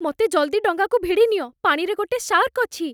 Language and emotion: Odia, fearful